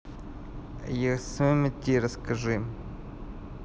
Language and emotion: Russian, neutral